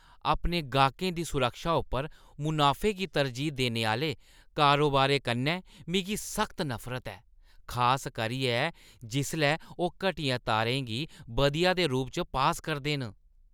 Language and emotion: Dogri, disgusted